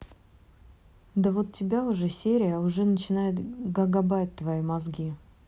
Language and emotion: Russian, neutral